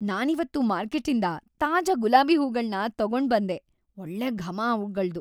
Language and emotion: Kannada, happy